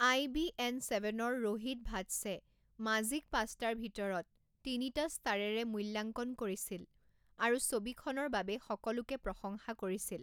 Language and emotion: Assamese, neutral